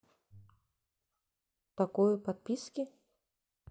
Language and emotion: Russian, neutral